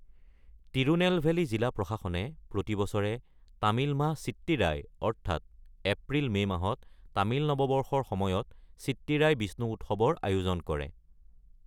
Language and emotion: Assamese, neutral